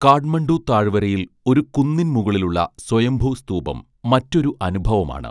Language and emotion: Malayalam, neutral